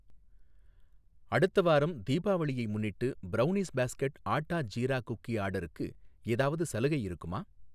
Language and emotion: Tamil, neutral